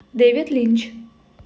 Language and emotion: Russian, neutral